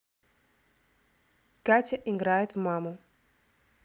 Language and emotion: Russian, neutral